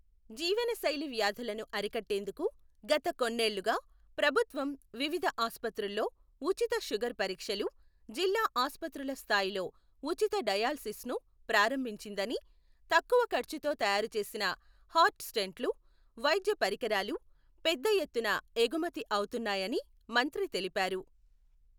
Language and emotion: Telugu, neutral